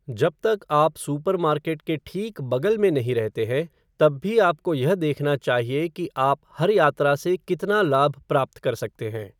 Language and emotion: Hindi, neutral